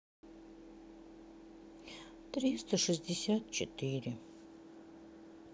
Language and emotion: Russian, sad